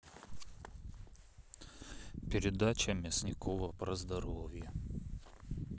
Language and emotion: Russian, neutral